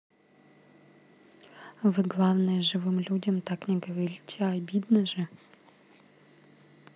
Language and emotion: Russian, neutral